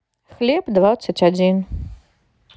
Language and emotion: Russian, neutral